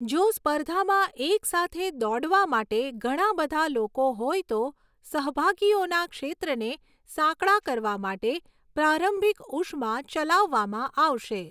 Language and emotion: Gujarati, neutral